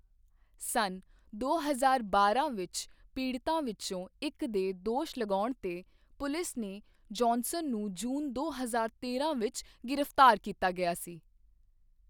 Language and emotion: Punjabi, neutral